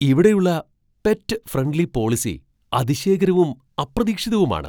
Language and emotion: Malayalam, surprised